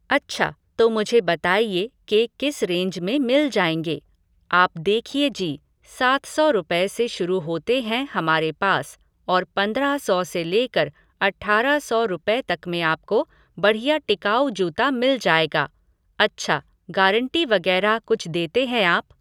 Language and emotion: Hindi, neutral